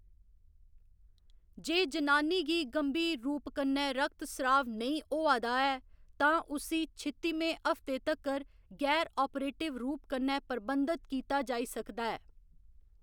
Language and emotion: Dogri, neutral